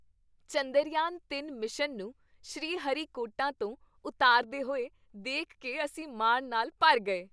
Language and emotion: Punjabi, happy